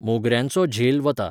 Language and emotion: Goan Konkani, neutral